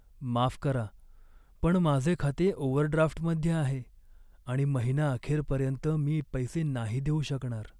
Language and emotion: Marathi, sad